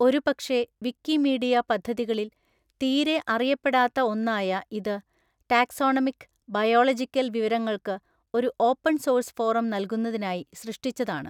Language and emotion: Malayalam, neutral